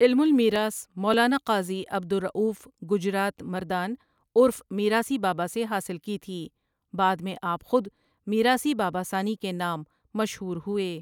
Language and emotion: Urdu, neutral